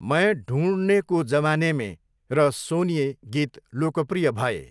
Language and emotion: Nepali, neutral